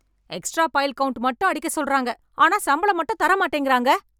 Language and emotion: Tamil, angry